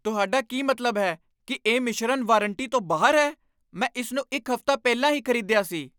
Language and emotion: Punjabi, angry